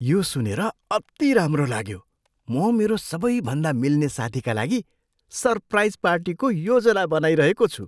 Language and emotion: Nepali, surprised